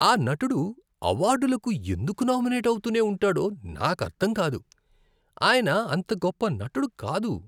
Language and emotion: Telugu, disgusted